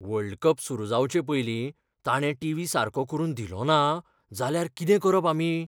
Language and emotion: Goan Konkani, fearful